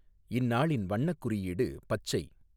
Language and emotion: Tamil, neutral